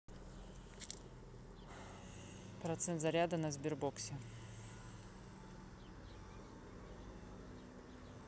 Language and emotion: Russian, neutral